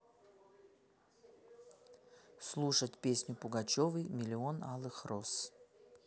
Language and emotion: Russian, neutral